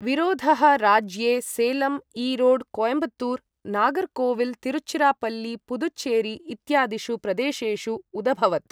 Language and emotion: Sanskrit, neutral